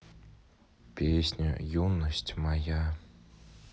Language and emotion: Russian, neutral